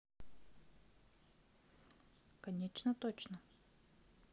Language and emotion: Russian, neutral